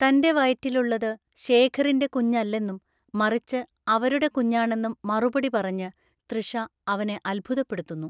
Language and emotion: Malayalam, neutral